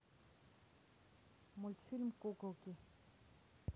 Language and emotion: Russian, neutral